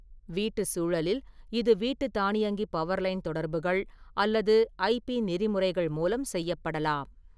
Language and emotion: Tamil, neutral